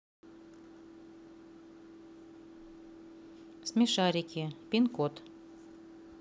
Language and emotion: Russian, neutral